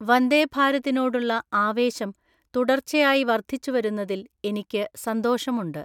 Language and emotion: Malayalam, neutral